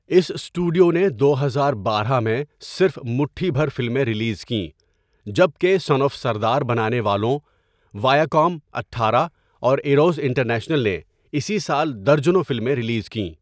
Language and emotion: Urdu, neutral